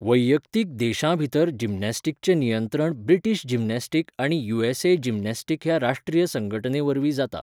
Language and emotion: Goan Konkani, neutral